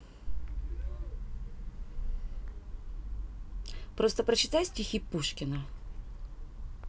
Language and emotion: Russian, neutral